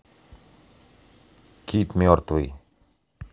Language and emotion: Russian, neutral